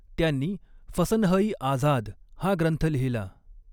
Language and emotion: Marathi, neutral